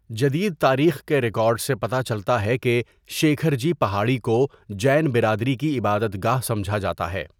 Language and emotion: Urdu, neutral